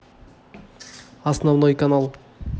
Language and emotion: Russian, neutral